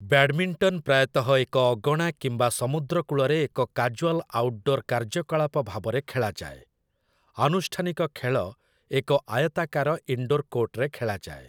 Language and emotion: Odia, neutral